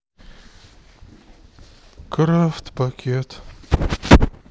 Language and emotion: Russian, sad